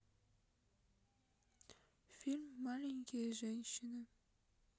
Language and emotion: Russian, sad